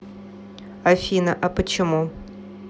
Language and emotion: Russian, neutral